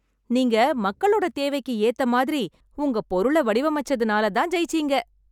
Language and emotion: Tamil, happy